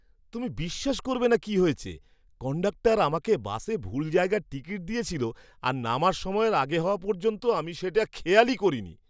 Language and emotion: Bengali, surprised